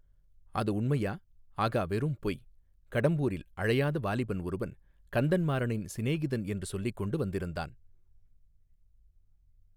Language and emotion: Tamil, neutral